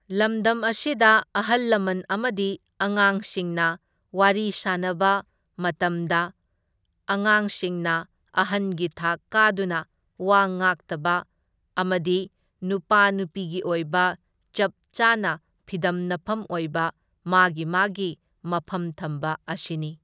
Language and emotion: Manipuri, neutral